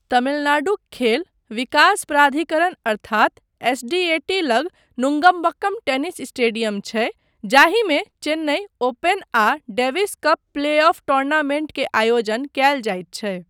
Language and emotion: Maithili, neutral